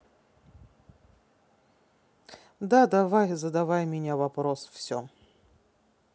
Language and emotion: Russian, neutral